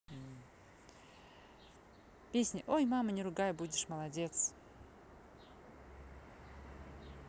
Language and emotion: Russian, neutral